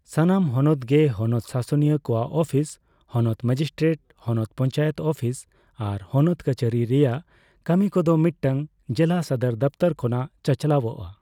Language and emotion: Santali, neutral